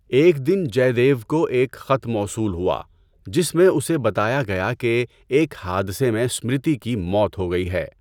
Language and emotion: Urdu, neutral